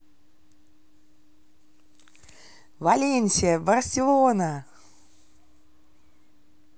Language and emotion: Russian, positive